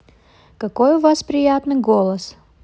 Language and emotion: Russian, neutral